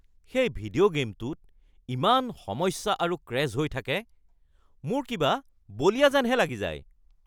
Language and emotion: Assamese, angry